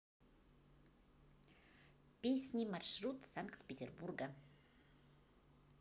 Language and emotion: Russian, positive